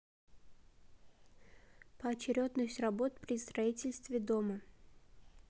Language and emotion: Russian, neutral